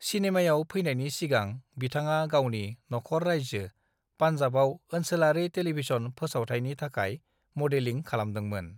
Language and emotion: Bodo, neutral